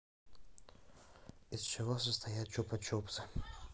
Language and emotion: Russian, neutral